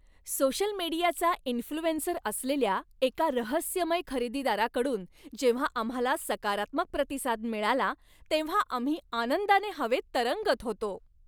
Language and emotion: Marathi, happy